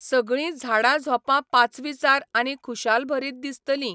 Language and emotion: Goan Konkani, neutral